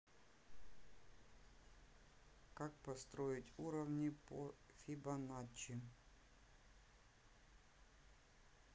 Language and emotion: Russian, neutral